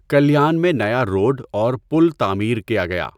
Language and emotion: Urdu, neutral